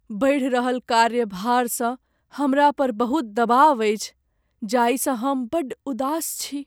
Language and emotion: Maithili, sad